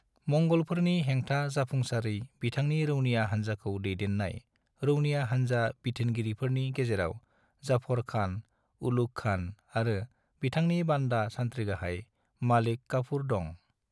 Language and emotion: Bodo, neutral